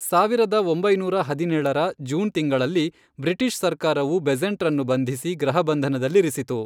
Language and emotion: Kannada, neutral